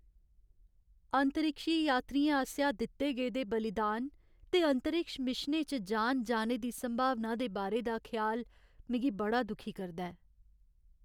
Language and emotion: Dogri, sad